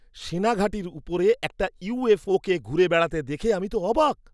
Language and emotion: Bengali, surprised